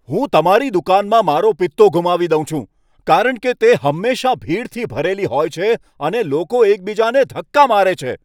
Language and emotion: Gujarati, angry